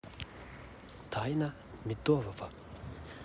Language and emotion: Russian, neutral